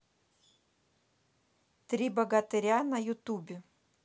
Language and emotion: Russian, neutral